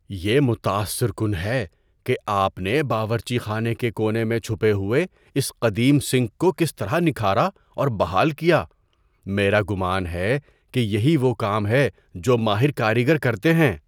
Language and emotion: Urdu, surprised